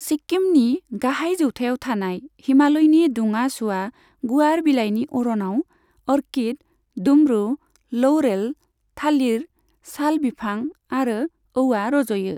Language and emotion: Bodo, neutral